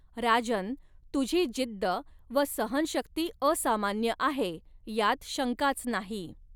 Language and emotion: Marathi, neutral